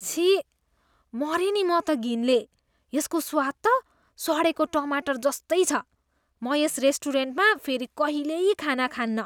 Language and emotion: Nepali, disgusted